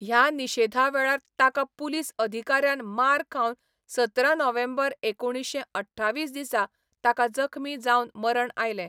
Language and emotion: Goan Konkani, neutral